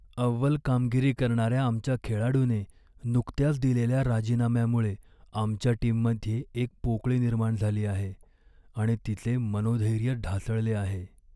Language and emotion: Marathi, sad